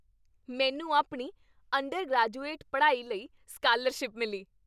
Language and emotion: Punjabi, happy